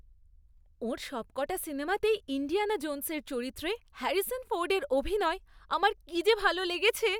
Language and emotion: Bengali, happy